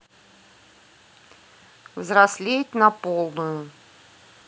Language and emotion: Russian, neutral